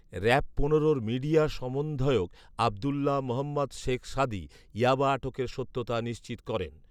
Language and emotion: Bengali, neutral